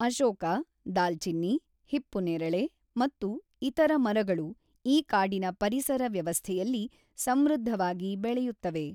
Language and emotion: Kannada, neutral